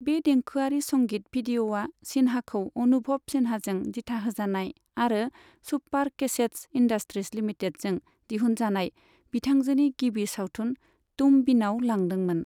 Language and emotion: Bodo, neutral